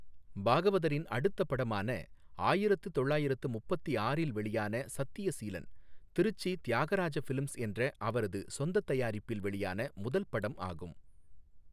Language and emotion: Tamil, neutral